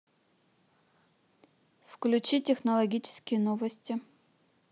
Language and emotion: Russian, neutral